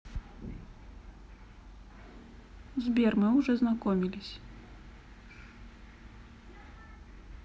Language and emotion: Russian, neutral